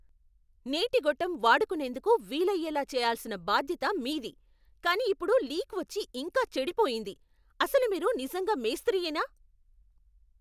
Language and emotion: Telugu, angry